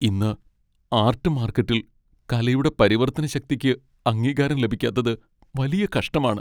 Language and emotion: Malayalam, sad